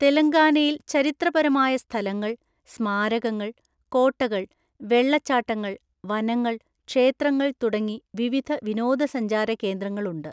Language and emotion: Malayalam, neutral